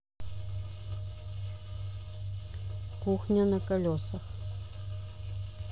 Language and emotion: Russian, neutral